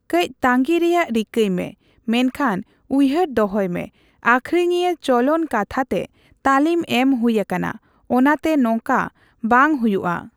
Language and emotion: Santali, neutral